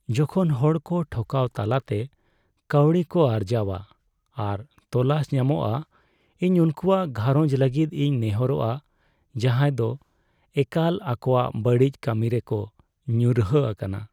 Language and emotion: Santali, sad